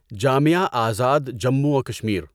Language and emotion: Urdu, neutral